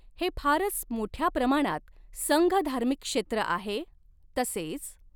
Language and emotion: Marathi, neutral